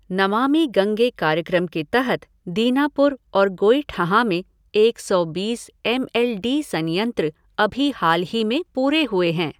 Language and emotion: Hindi, neutral